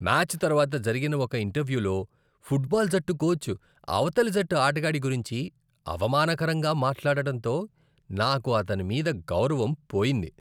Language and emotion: Telugu, disgusted